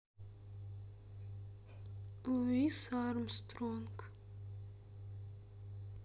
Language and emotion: Russian, sad